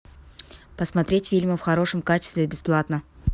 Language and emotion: Russian, neutral